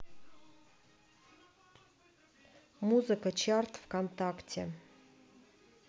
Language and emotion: Russian, neutral